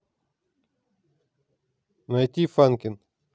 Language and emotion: Russian, neutral